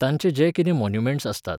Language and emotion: Goan Konkani, neutral